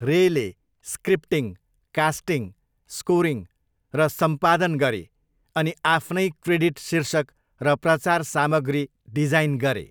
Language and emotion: Nepali, neutral